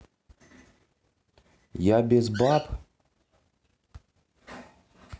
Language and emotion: Russian, neutral